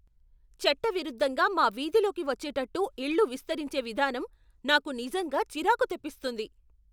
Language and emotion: Telugu, angry